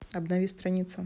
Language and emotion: Russian, neutral